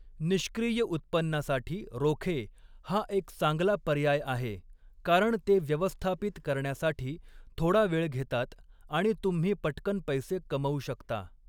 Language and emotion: Marathi, neutral